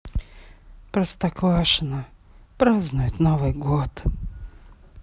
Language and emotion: Russian, sad